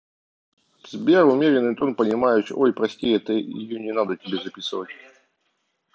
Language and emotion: Russian, neutral